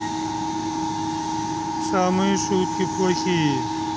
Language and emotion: Russian, neutral